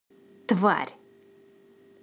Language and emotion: Russian, angry